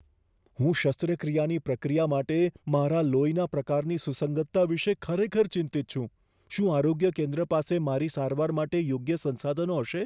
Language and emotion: Gujarati, fearful